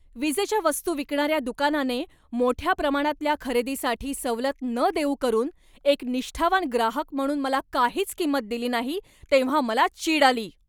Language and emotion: Marathi, angry